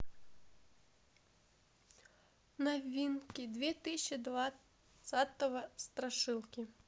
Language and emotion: Russian, neutral